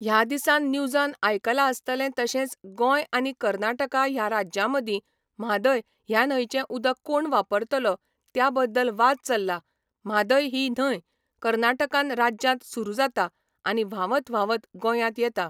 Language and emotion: Goan Konkani, neutral